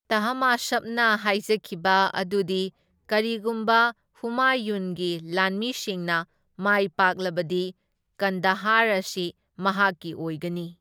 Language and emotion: Manipuri, neutral